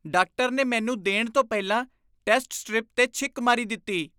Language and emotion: Punjabi, disgusted